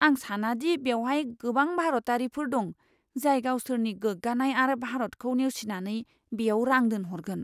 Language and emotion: Bodo, fearful